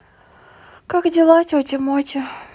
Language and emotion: Russian, sad